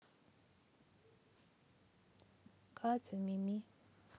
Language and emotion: Russian, neutral